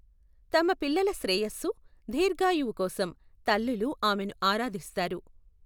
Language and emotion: Telugu, neutral